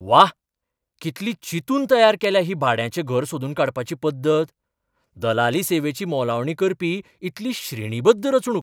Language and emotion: Goan Konkani, surprised